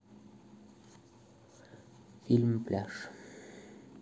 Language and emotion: Russian, neutral